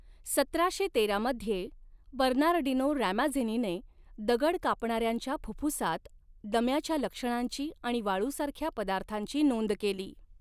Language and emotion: Marathi, neutral